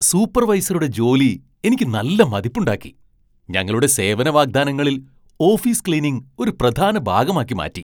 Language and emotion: Malayalam, surprised